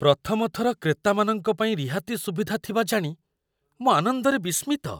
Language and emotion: Odia, surprised